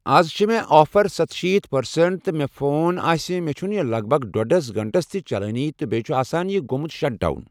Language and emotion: Kashmiri, neutral